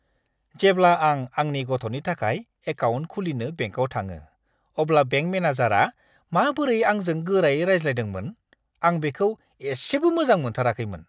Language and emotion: Bodo, disgusted